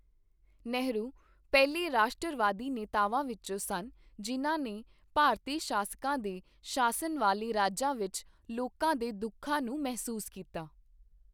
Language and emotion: Punjabi, neutral